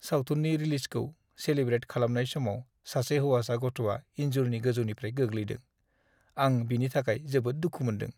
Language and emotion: Bodo, sad